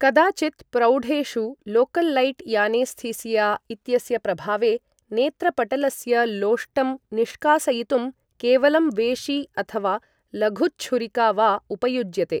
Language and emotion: Sanskrit, neutral